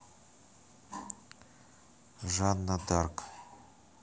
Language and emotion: Russian, neutral